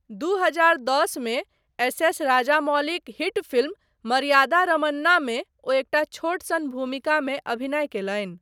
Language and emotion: Maithili, neutral